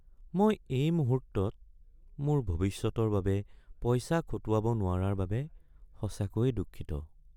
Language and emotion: Assamese, sad